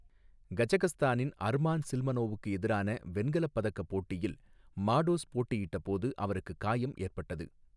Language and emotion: Tamil, neutral